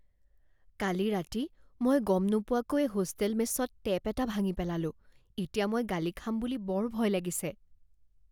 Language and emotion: Assamese, fearful